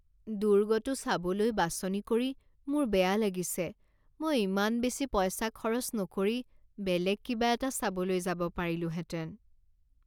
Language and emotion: Assamese, sad